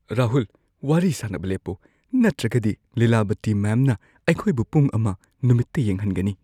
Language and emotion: Manipuri, fearful